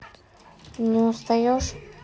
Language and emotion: Russian, neutral